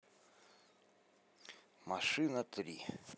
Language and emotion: Russian, neutral